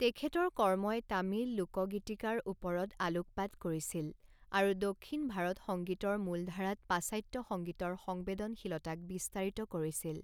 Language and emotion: Assamese, neutral